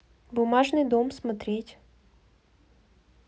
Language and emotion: Russian, neutral